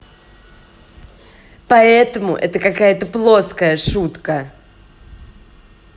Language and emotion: Russian, angry